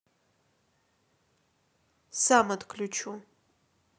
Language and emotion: Russian, neutral